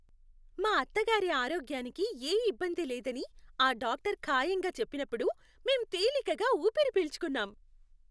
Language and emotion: Telugu, happy